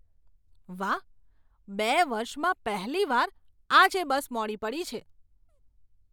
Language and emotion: Gujarati, surprised